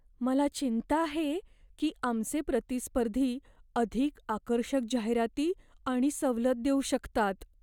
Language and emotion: Marathi, fearful